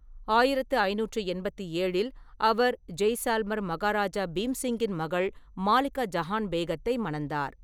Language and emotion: Tamil, neutral